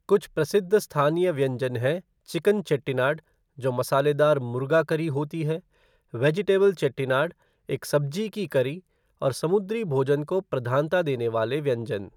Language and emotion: Hindi, neutral